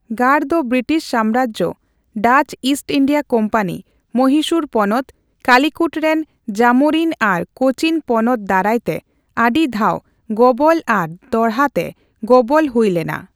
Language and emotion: Santali, neutral